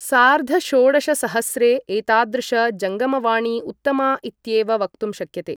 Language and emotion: Sanskrit, neutral